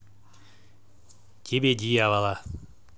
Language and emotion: Russian, angry